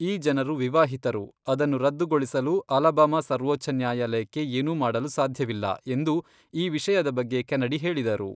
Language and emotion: Kannada, neutral